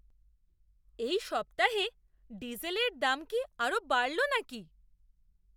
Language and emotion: Bengali, surprised